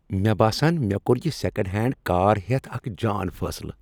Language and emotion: Kashmiri, happy